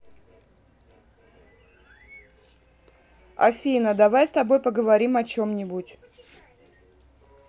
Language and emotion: Russian, neutral